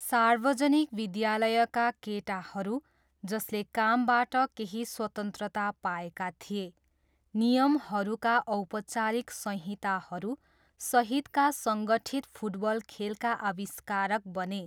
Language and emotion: Nepali, neutral